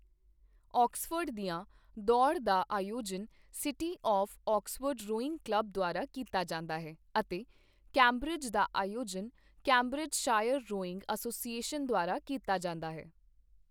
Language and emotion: Punjabi, neutral